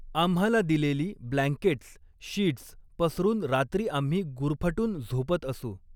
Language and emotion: Marathi, neutral